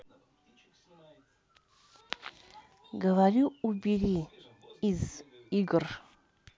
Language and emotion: Russian, neutral